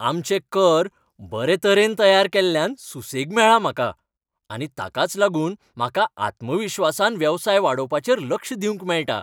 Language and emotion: Goan Konkani, happy